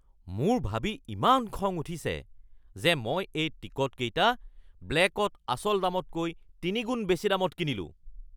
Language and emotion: Assamese, angry